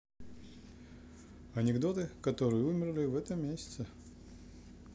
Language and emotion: Russian, neutral